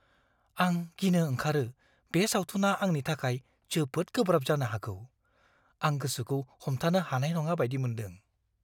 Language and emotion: Bodo, fearful